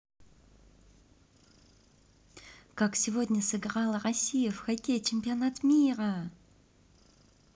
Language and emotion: Russian, positive